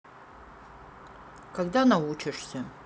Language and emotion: Russian, sad